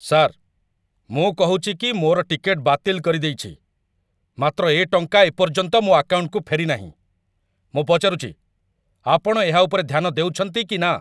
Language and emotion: Odia, angry